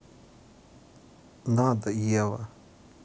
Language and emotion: Russian, sad